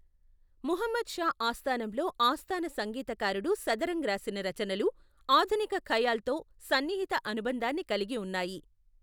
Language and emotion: Telugu, neutral